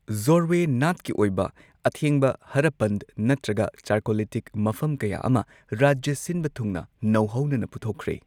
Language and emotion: Manipuri, neutral